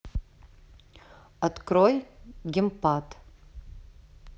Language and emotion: Russian, neutral